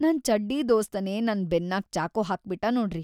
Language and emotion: Kannada, sad